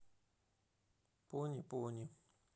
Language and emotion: Russian, neutral